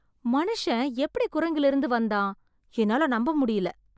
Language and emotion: Tamil, surprised